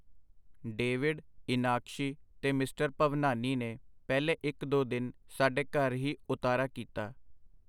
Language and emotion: Punjabi, neutral